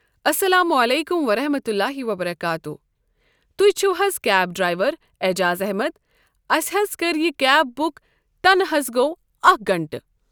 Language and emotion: Kashmiri, neutral